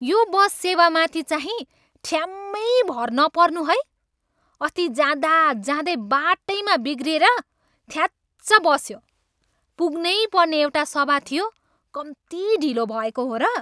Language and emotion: Nepali, angry